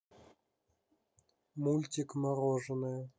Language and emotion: Russian, neutral